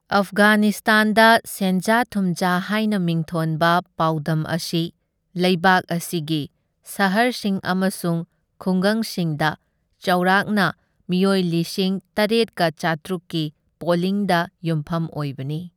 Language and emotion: Manipuri, neutral